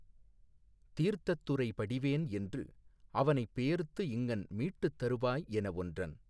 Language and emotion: Tamil, neutral